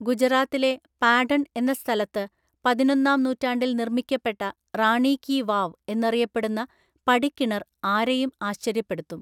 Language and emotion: Malayalam, neutral